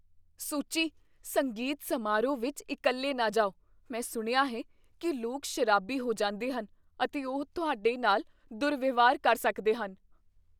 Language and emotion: Punjabi, fearful